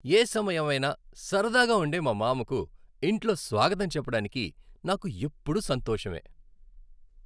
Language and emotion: Telugu, happy